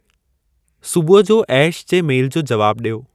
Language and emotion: Sindhi, neutral